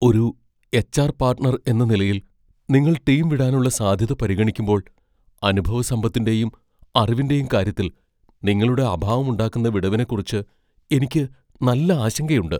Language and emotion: Malayalam, fearful